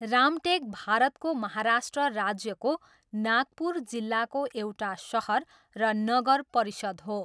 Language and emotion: Nepali, neutral